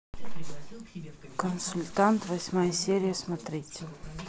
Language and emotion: Russian, neutral